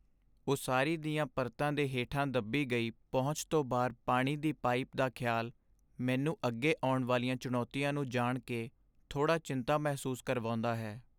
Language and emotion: Punjabi, sad